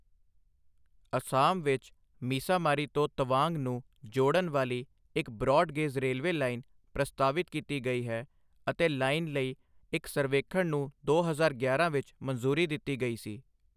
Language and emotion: Punjabi, neutral